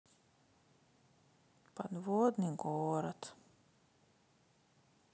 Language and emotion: Russian, sad